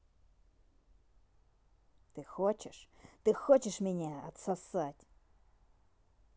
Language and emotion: Russian, angry